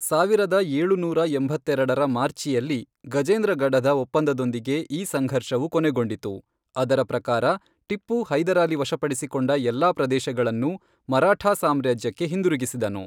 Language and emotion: Kannada, neutral